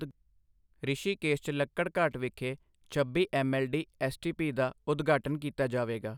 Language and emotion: Punjabi, neutral